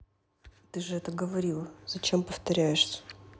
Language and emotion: Russian, neutral